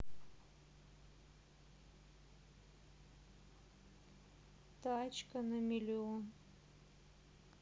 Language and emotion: Russian, sad